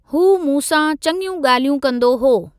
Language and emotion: Sindhi, neutral